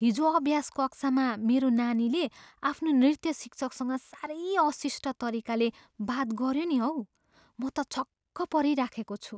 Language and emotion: Nepali, surprised